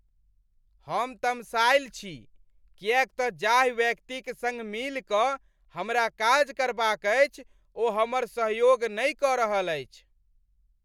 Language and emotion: Maithili, angry